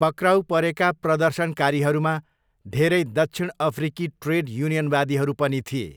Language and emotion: Nepali, neutral